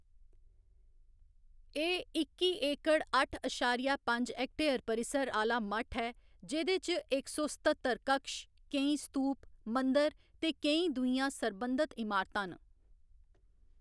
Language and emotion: Dogri, neutral